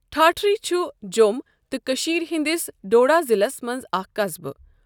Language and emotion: Kashmiri, neutral